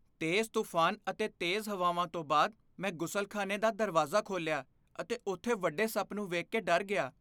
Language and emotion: Punjabi, fearful